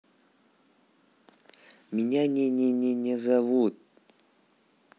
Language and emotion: Russian, neutral